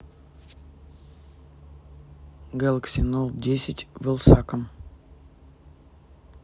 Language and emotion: Russian, neutral